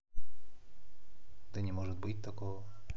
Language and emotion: Russian, neutral